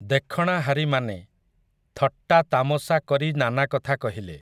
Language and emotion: Odia, neutral